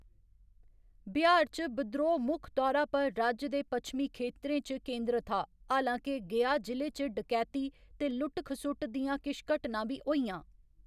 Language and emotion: Dogri, neutral